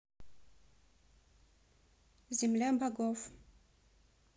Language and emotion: Russian, neutral